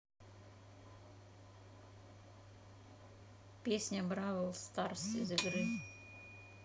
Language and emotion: Russian, neutral